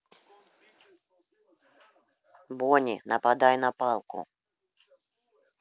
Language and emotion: Russian, neutral